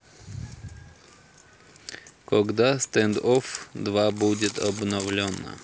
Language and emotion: Russian, neutral